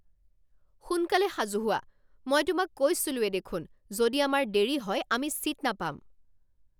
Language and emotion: Assamese, angry